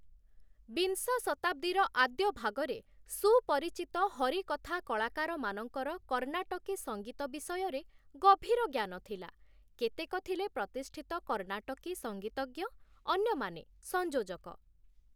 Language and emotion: Odia, neutral